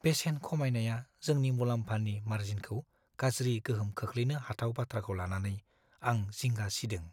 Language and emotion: Bodo, fearful